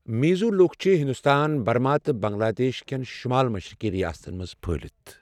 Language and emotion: Kashmiri, neutral